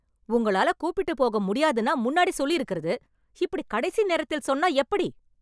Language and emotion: Tamil, angry